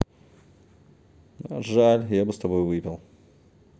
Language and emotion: Russian, sad